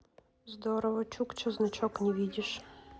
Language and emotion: Russian, neutral